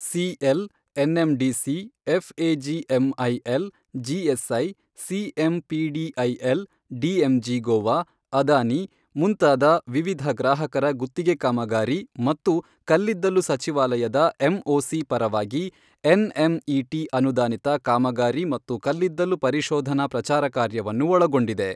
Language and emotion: Kannada, neutral